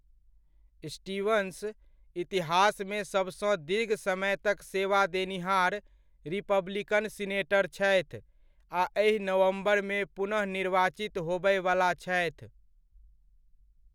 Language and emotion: Maithili, neutral